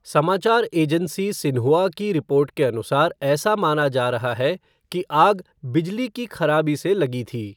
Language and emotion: Hindi, neutral